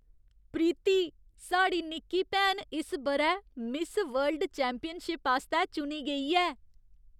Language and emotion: Dogri, surprised